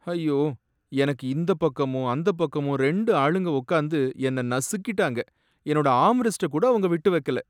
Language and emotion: Tamil, sad